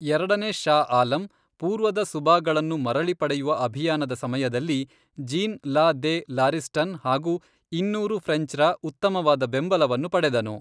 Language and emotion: Kannada, neutral